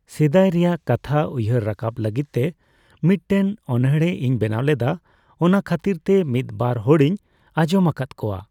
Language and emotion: Santali, neutral